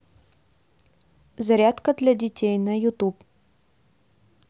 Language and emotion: Russian, neutral